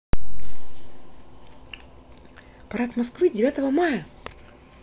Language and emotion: Russian, positive